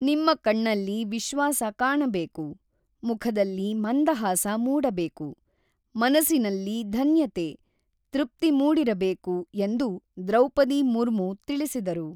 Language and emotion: Kannada, neutral